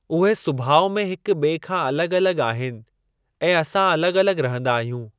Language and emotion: Sindhi, neutral